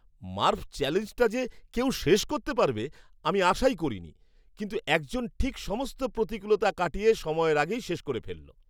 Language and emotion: Bengali, surprised